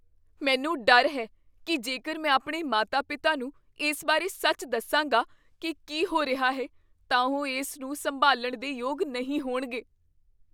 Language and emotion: Punjabi, fearful